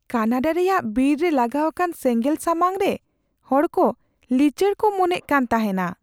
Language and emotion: Santali, fearful